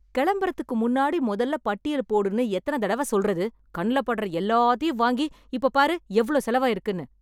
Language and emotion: Tamil, angry